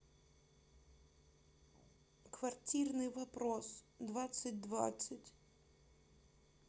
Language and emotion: Russian, sad